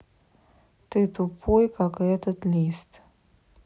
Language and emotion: Russian, neutral